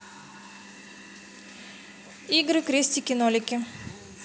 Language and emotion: Russian, neutral